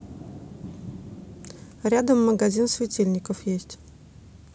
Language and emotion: Russian, neutral